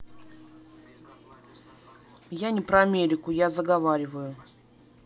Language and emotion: Russian, neutral